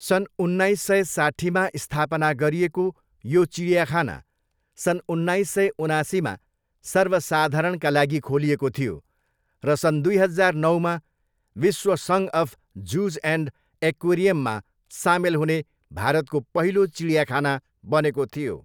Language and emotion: Nepali, neutral